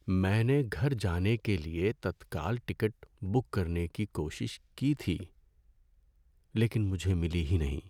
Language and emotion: Urdu, sad